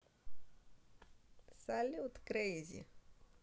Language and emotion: Russian, positive